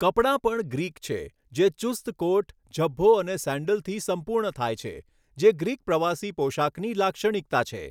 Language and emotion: Gujarati, neutral